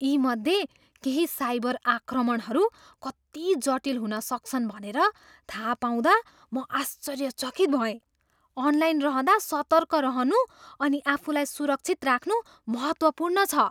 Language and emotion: Nepali, surprised